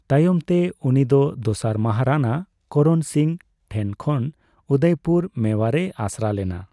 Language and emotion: Santali, neutral